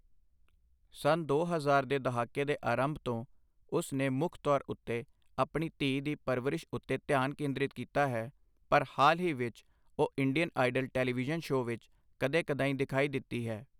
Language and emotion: Punjabi, neutral